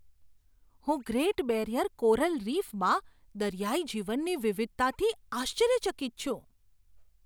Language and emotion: Gujarati, surprised